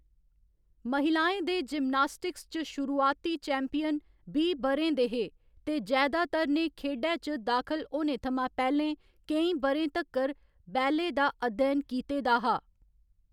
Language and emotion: Dogri, neutral